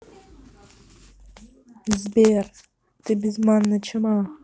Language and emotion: Russian, neutral